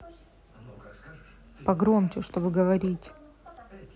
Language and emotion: Russian, neutral